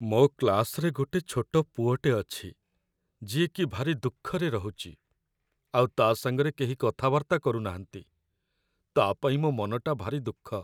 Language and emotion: Odia, sad